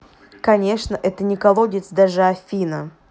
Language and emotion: Russian, neutral